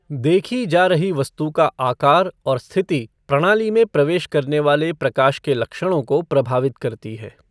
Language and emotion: Hindi, neutral